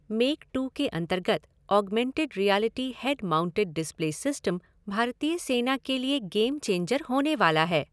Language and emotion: Hindi, neutral